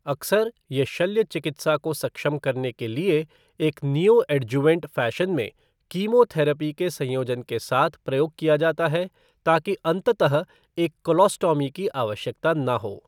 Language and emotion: Hindi, neutral